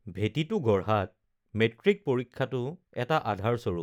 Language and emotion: Assamese, neutral